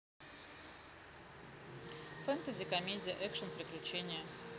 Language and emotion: Russian, neutral